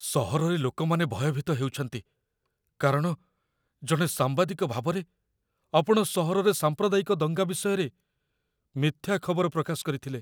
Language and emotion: Odia, fearful